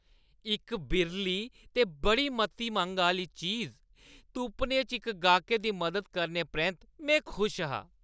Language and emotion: Dogri, happy